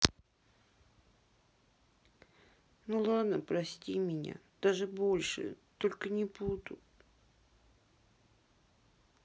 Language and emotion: Russian, sad